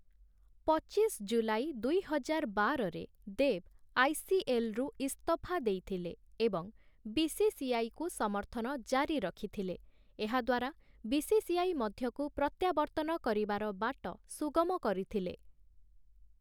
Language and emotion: Odia, neutral